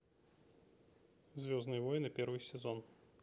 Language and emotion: Russian, neutral